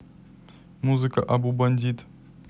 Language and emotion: Russian, neutral